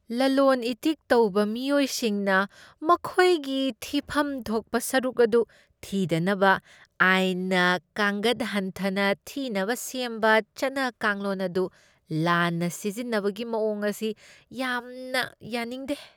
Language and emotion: Manipuri, disgusted